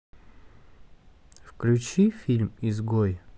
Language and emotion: Russian, neutral